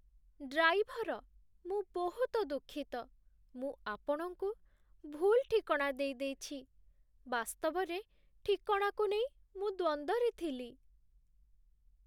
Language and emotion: Odia, sad